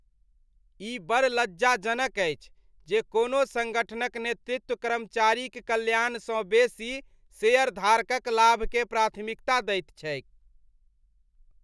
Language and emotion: Maithili, disgusted